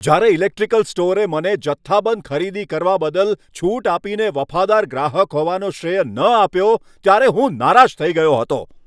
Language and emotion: Gujarati, angry